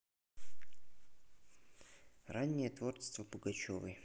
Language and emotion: Russian, neutral